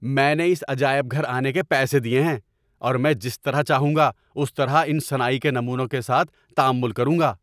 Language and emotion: Urdu, angry